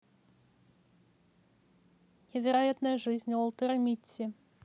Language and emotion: Russian, neutral